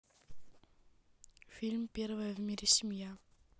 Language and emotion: Russian, neutral